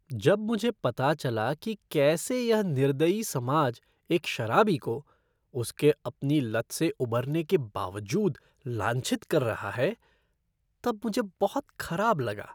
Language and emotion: Hindi, disgusted